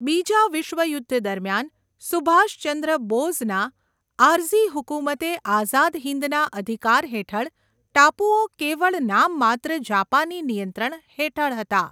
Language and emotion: Gujarati, neutral